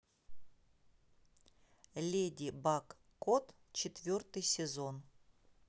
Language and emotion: Russian, neutral